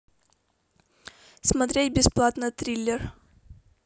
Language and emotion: Russian, neutral